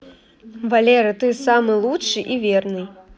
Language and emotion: Russian, positive